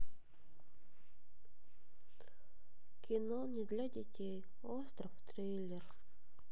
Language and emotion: Russian, sad